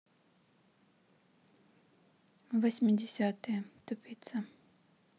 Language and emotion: Russian, neutral